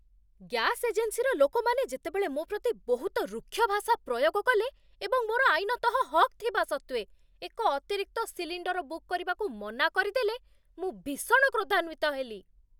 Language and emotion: Odia, angry